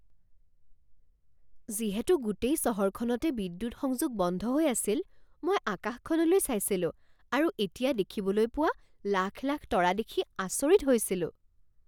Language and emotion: Assamese, surprised